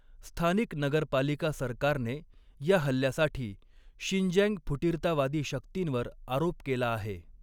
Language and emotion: Marathi, neutral